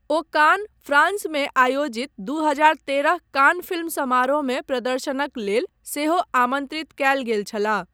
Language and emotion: Maithili, neutral